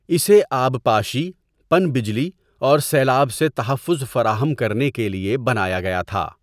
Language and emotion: Urdu, neutral